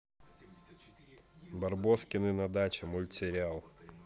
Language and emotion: Russian, neutral